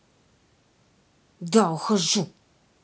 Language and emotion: Russian, angry